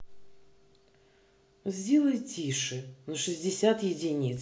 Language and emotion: Russian, angry